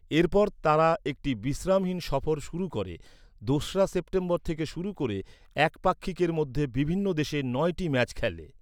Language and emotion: Bengali, neutral